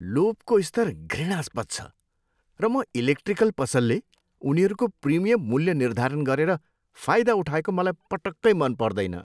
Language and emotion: Nepali, disgusted